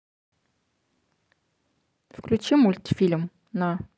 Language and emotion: Russian, neutral